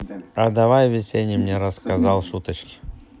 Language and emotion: Russian, neutral